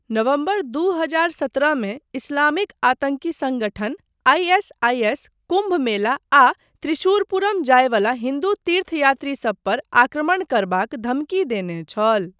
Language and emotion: Maithili, neutral